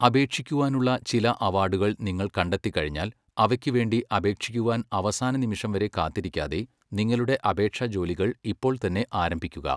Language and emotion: Malayalam, neutral